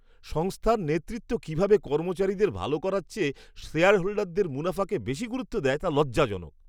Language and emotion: Bengali, disgusted